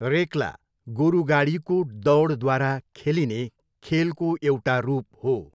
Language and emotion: Nepali, neutral